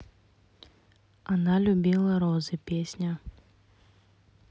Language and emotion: Russian, neutral